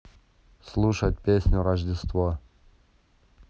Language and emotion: Russian, neutral